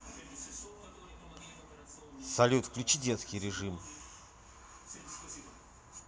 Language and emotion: Russian, neutral